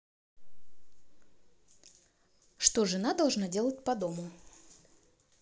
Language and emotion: Russian, positive